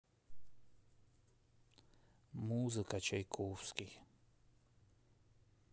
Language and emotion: Russian, neutral